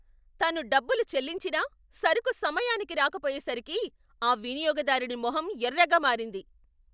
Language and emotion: Telugu, angry